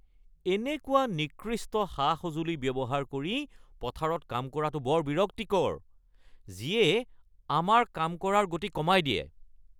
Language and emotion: Assamese, angry